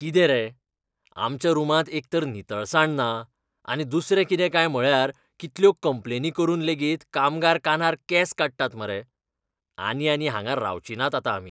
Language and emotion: Goan Konkani, disgusted